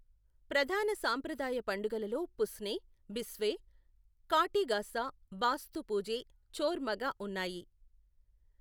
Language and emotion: Telugu, neutral